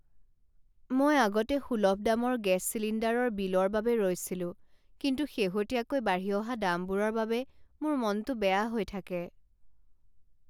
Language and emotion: Assamese, sad